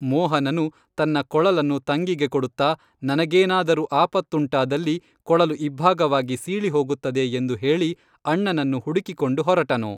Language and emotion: Kannada, neutral